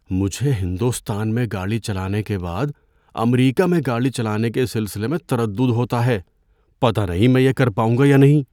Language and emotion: Urdu, fearful